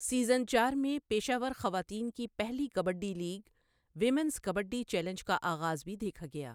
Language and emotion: Urdu, neutral